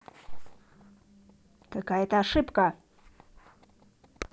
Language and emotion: Russian, angry